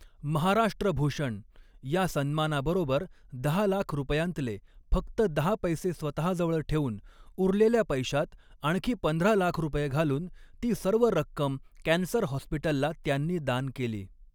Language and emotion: Marathi, neutral